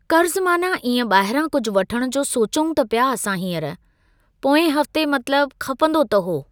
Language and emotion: Sindhi, neutral